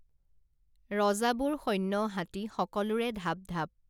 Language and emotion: Assamese, neutral